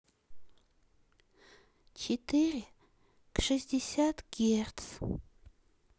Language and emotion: Russian, sad